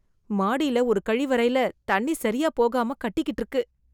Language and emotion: Tamil, disgusted